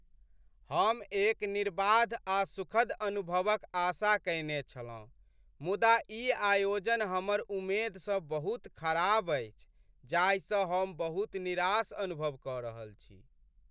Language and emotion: Maithili, sad